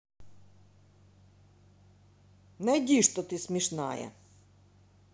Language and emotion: Russian, positive